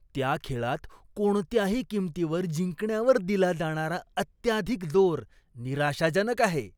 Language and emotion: Marathi, disgusted